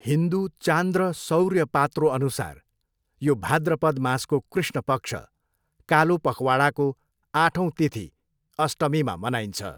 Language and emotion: Nepali, neutral